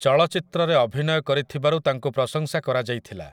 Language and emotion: Odia, neutral